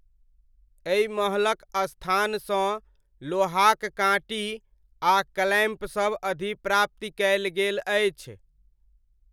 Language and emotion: Maithili, neutral